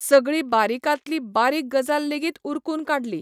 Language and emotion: Goan Konkani, neutral